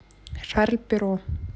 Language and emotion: Russian, neutral